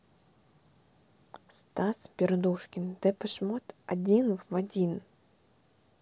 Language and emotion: Russian, neutral